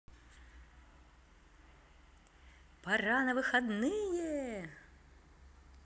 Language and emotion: Russian, positive